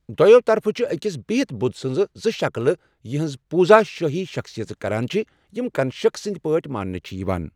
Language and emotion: Kashmiri, neutral